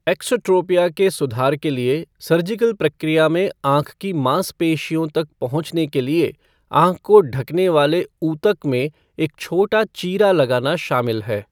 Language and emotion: Hindi, neutral